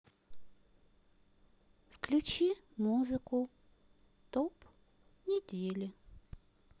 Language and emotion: Russian, neutral